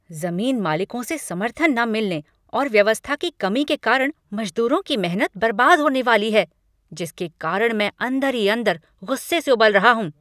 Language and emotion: Hindi, angry